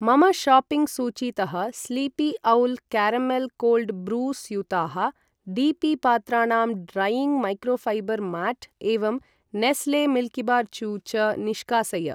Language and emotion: Sanskrit, neutral